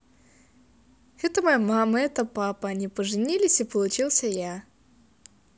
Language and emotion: Russian, positive